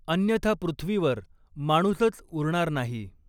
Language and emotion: Marathi, neutral